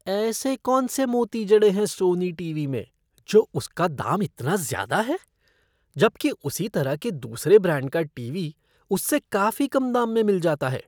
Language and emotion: Hindi, disgusted